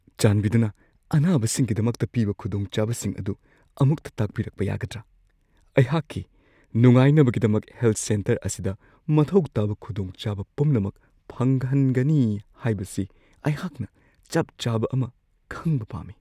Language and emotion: Manipuri, fearful